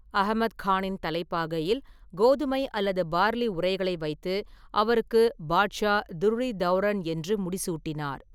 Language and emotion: Tamil, neutral